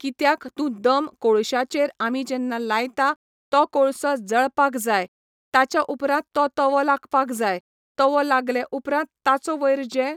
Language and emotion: Goan Konkani, neutral